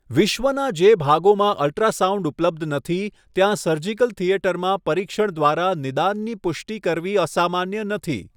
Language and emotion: Gujarati, neutral